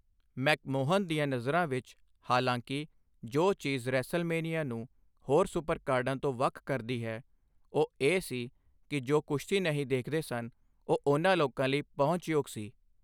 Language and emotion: Punjabi, neutral